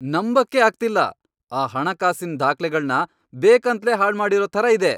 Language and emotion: Kannada, angry